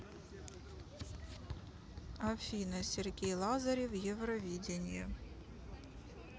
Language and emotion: Russian, neutral